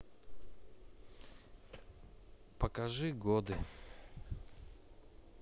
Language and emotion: Russian, sad